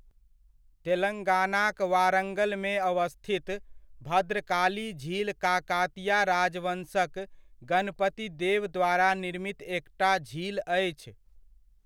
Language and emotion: Maithili, neutral